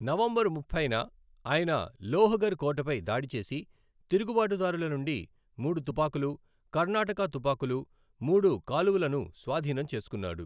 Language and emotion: Telugu, neutral